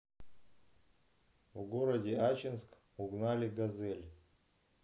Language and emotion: Russian, neutral